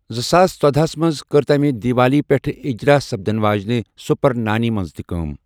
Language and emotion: Kashmiri, neutral